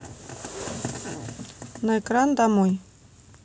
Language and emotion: Russian, neutral